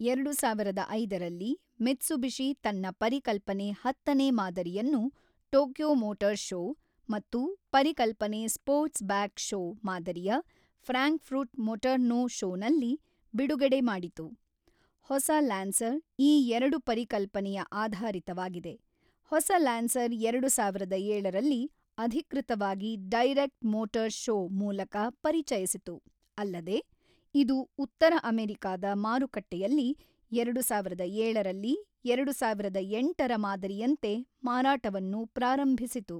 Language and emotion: Kannada, neutral